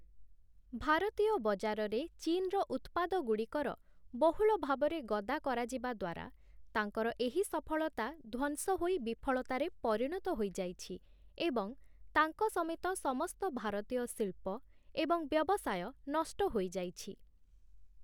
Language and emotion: Odia, neutral